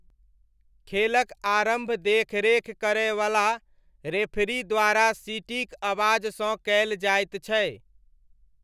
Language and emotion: Maithili, neutral